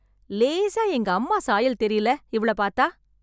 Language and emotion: Tamil, happy